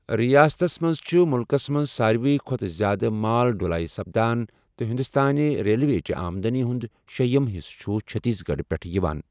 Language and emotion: Kashmiri, neutral